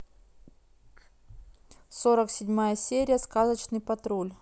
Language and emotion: Russian, neutral